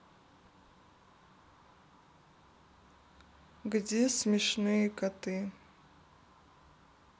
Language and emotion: Russian, neutral